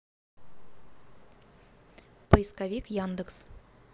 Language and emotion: Russian, neutral